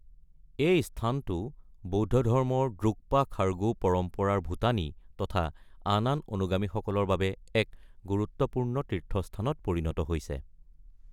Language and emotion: Assamese, neutral